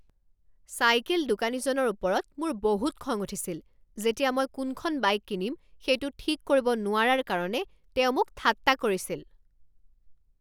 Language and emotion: Assamese, angry